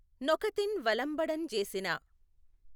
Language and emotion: Telugu, neutral